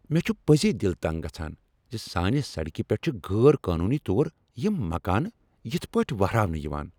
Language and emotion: Kashmiri, angry